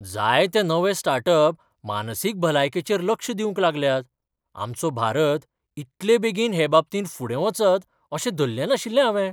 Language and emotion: Goan Konkani, surprised